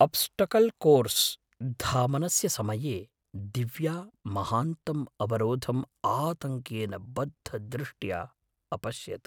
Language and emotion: Sanskrit, fearful